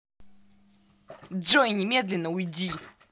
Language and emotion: Russian, angry